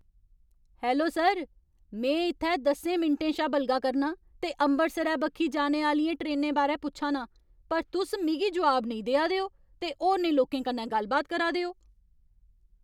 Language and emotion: Dogri, angry